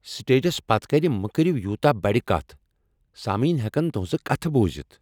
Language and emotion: Kashmiri, angry